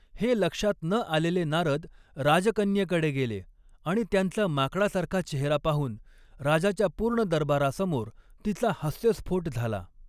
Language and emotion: Marathi, neutral